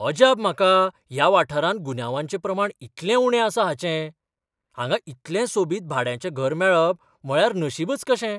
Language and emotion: Goan Konkani, surprised